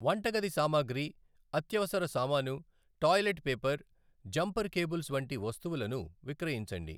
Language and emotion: Telugu, neutral